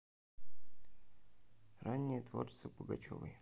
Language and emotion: Russian, neutral